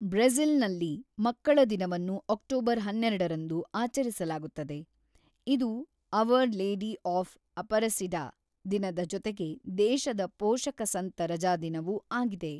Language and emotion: Kannada, neutral